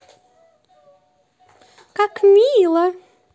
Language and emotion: Russian, positive